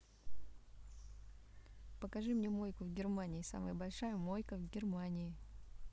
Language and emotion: Russian, neutral